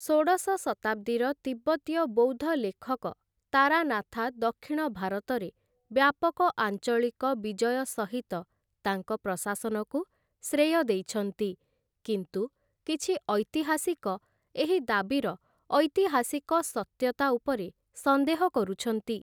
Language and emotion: Odia, neutral